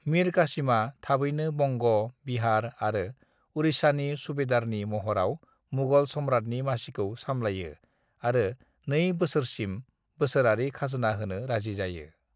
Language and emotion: Bodo, neutral